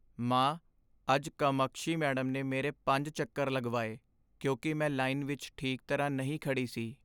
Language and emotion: Punjabi, sad